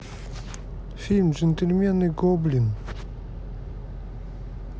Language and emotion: Russian, neutral